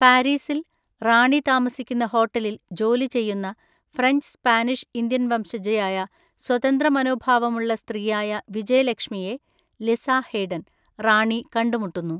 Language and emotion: Malayalam, neutral